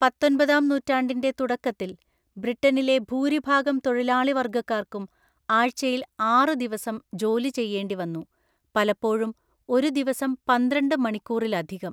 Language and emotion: Malayalam, neutral